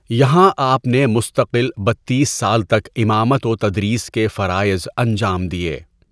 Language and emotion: Urdu, neutral